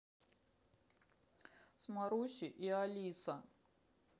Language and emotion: Russian, sad